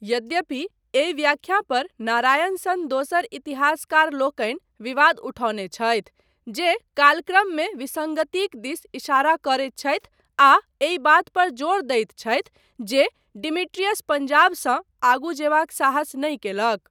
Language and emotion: Maithili, neutral